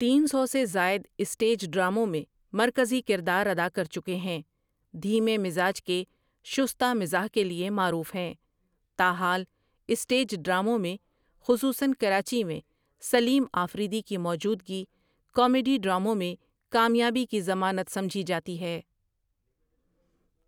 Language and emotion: Urdu, neutral